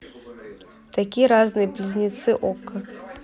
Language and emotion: Russian, neutral